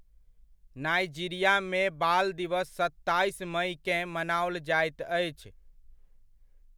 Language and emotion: Maithili, neutral